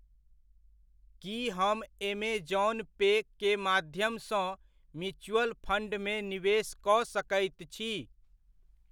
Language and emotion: Maithili, neutral